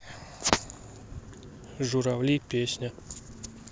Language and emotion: Russian, neutral